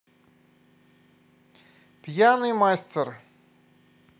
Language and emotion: Russian, positive